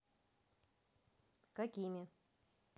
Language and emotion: Russian, neutral